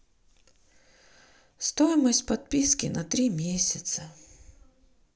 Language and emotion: Russian, sad